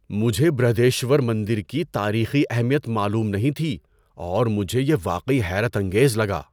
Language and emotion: Urdu, surprised